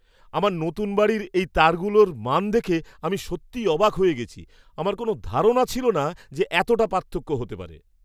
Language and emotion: Bengali, surprised